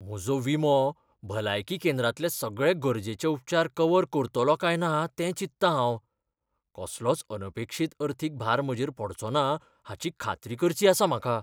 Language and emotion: Goan Konkani, fearful